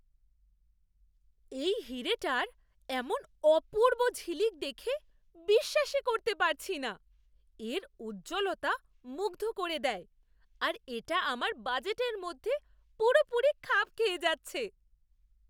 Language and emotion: Bengali, surprised